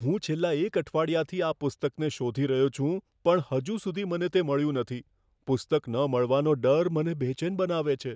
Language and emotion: Gujarati, fearful